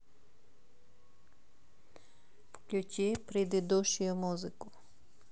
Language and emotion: Russian, neutral